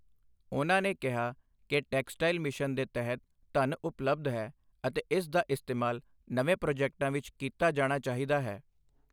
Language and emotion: Punjabi, neutral